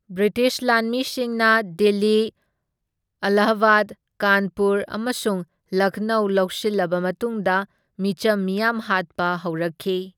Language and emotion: Manipuri, neutral